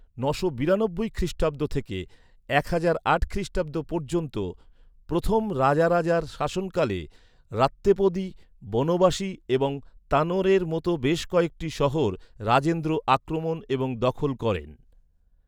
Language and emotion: Bengali, neutral